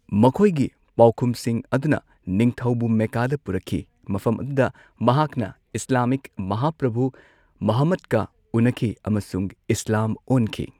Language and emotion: Manipuri, neutral